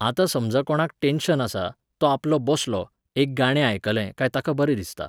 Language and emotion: Goan Konkani, neutral